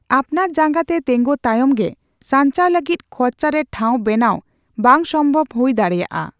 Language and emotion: Santali, neutral